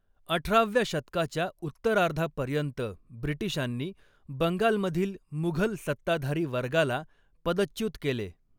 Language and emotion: Marathi, neutral